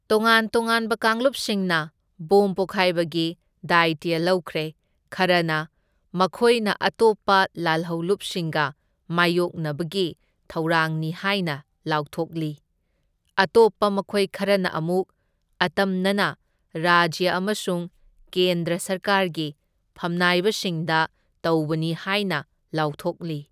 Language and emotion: Manipuri, neutral